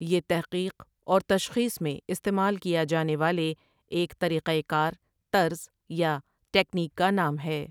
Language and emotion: Urdu, neutral